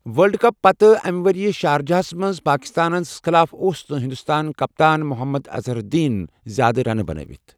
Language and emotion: Kashmiri, neutral